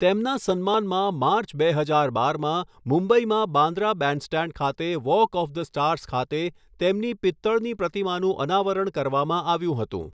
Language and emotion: Gujarati, neutral